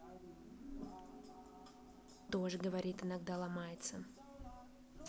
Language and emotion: Russian, neutral